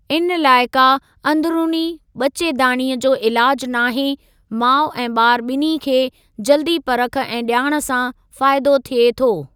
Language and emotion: Sindhi, neutral